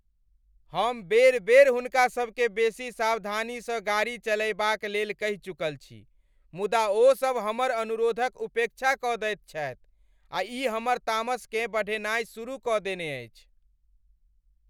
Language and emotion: Maithili, angry